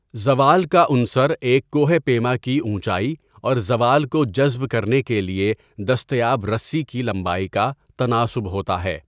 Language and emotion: Urdu, neutral